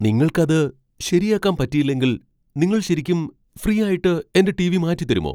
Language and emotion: Malayalam, surprised